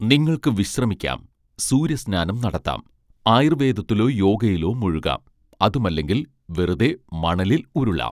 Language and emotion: Malayalam, neutral